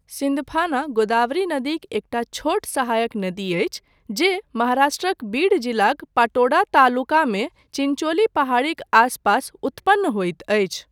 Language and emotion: Maithili, neutral